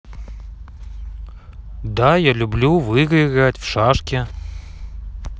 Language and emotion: Russian, neutral